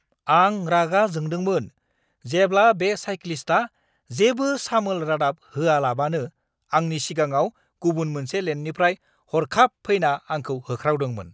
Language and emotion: Bodo, angry